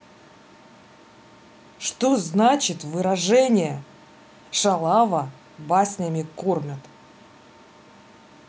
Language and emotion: Russian, neutral